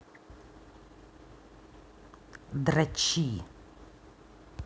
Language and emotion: Russian, angry